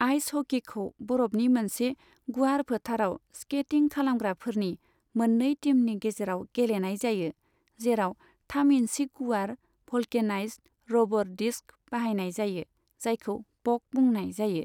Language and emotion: Bodo, neutral